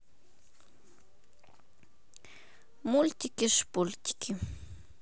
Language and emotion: Russian, neutral